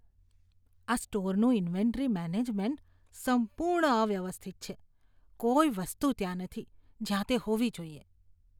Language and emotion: Gujarati, disgusted